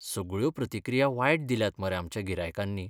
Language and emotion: Goan Konkani, sad